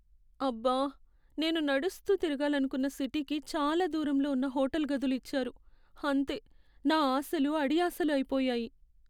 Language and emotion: Telugu, sad